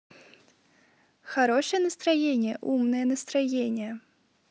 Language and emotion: Russian, positive